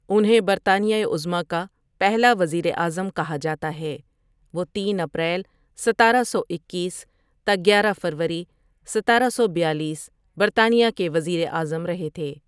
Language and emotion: Urdu, neutral